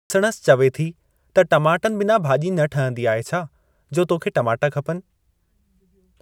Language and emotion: Sindhi, neutral